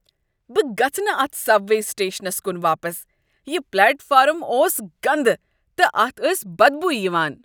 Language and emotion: Kashmiri, disgusted